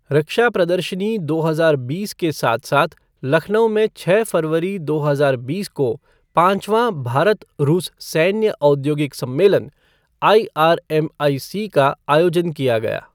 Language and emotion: Hindi, neutral